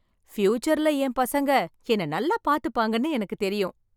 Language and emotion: Tamil, happy